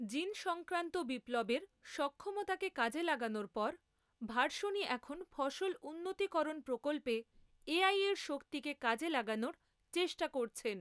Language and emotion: Bengali, neutral